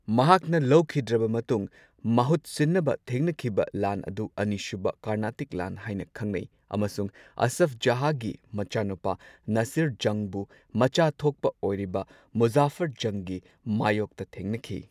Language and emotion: Manipuri, neutral